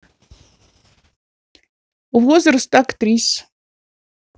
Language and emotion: Russian, neutral